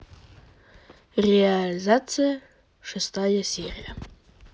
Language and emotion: Russian, neutral